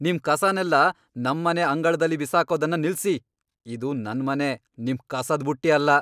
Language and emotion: Kannada, angry